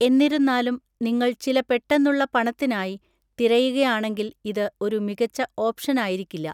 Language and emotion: Malayalam, neutral